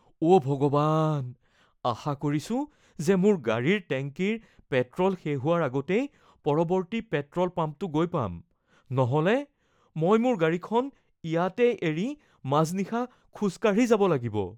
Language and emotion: Assamese, fearful